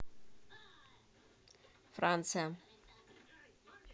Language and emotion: Russian, neutral